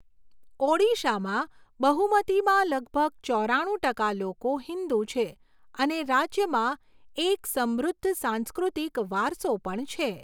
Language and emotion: Gujarati, neutral